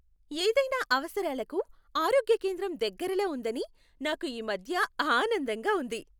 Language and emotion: Telugu, happy